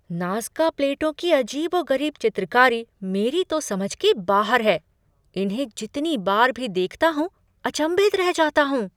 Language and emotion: Hindi, surprised